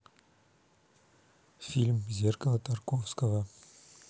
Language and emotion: Russian, neutral